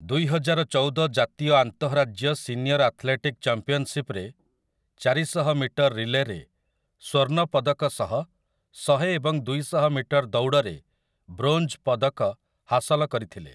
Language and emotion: Odia, neutral